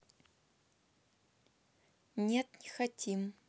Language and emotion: Russian, neutral